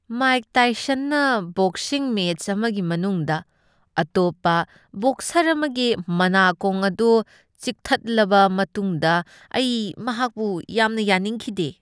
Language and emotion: Manipuri, disgusted